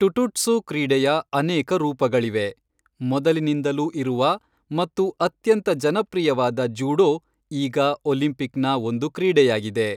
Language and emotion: Kannada, neutral